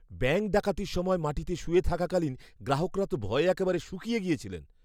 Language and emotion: Bengali, fearful